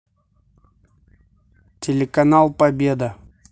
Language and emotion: Russian, neutral